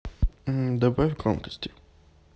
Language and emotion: Russian, neutral